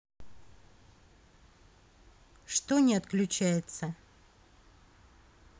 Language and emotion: Russian, neutral